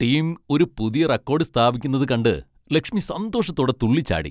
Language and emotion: Malayalam, happy